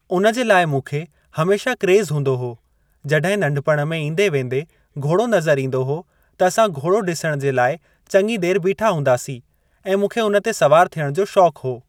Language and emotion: Sindhi, neutral